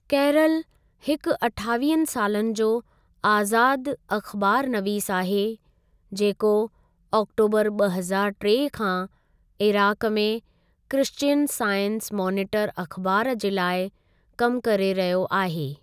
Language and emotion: Sindhi, neutral